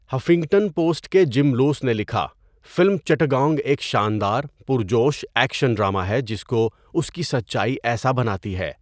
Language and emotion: Urdu, neutral